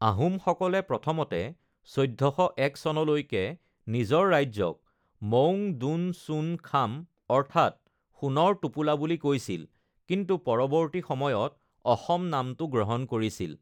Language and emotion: Assamese, neutral